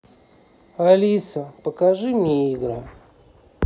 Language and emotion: Russian, sad